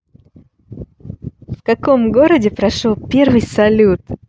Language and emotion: Russian, positive